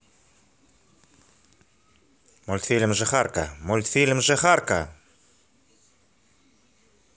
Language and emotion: Russian, angry